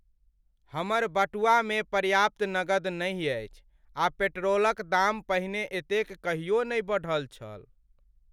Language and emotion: Maithili, sad